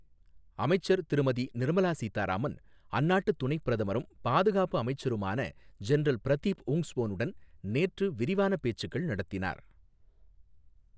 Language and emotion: Tamil, neutral